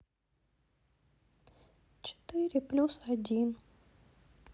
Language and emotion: Russian, sad